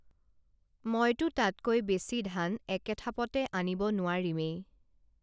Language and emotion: Assamese, neutral